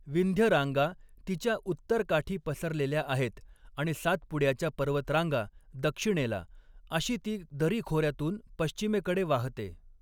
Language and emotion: Marathi, neutral